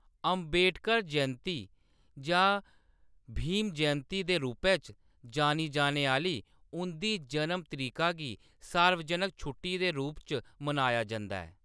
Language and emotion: Dogri, neutral